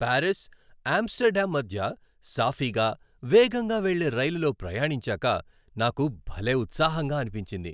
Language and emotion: Telugu, happy